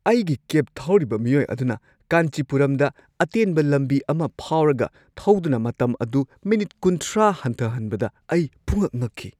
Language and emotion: Manipuri, surprised